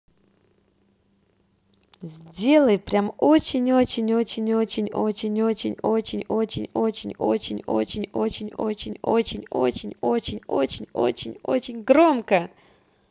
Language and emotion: Russian, positive